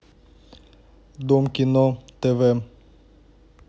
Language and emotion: Russian, neutral